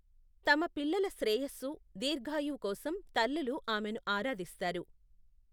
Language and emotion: Telugu, neutral